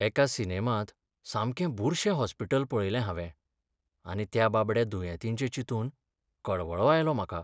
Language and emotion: Goan Konkani, sad